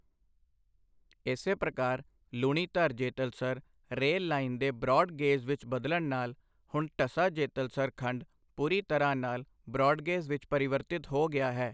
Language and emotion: Punjabi, neutral